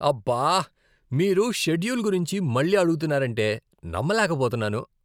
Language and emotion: Telugu, disgusted